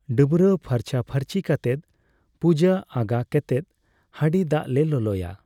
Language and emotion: Santali, neutral